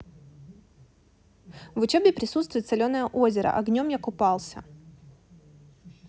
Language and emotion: Russian, neutral